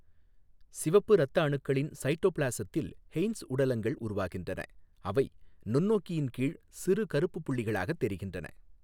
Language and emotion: Tamil, neutral